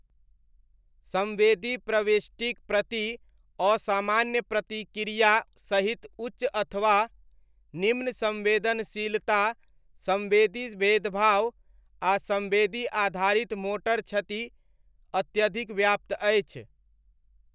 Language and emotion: Maithili, neutral